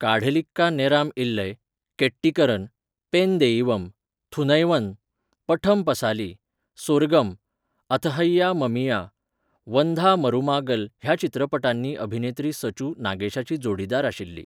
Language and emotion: Goan Konkani, neutral